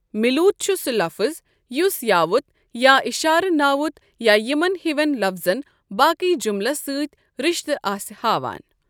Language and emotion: Kashmiri, neutral